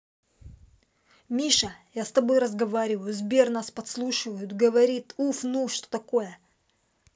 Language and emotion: Russian, angry